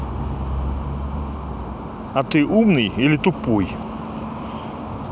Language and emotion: Russian, neutral